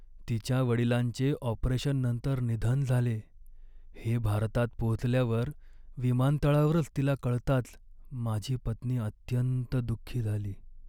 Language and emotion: Marathi, sad